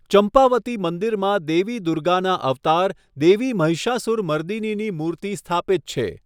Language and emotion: Gujarati, neutral